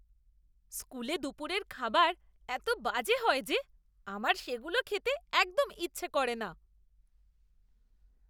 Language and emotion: Bengali, disgusted